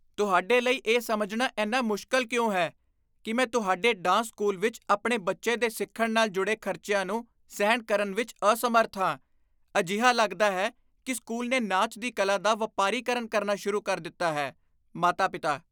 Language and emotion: Punjabi, disgusted